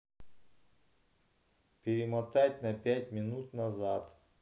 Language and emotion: Russian, neutral